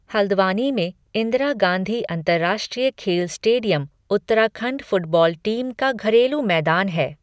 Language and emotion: Hindi, neutral